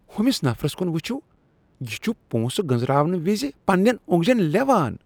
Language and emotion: Kashmiri, disgusted